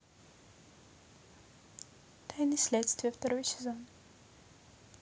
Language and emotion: Russian, neutral